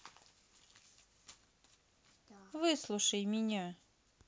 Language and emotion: Russian, neutral